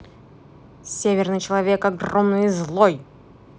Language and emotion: Russian, angry